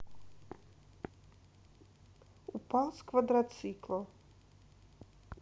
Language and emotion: Russian, neutral